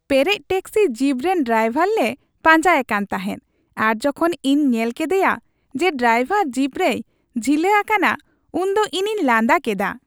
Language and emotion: Santali, happy